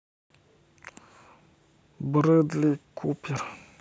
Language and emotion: Russian, neutral